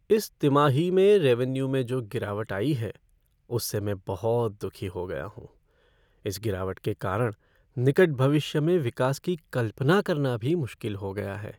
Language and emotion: Hindi, sad